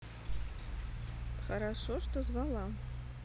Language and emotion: Russian, neutral